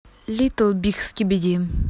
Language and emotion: Russian, neutral